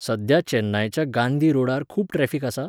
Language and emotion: Goan Konkani, neutral